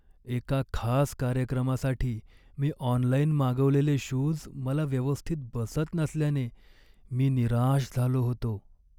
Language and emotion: Marathi, sad